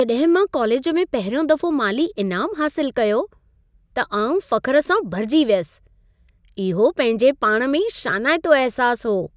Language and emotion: Sindhi, happy